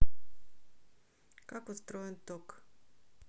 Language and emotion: Russian, neutral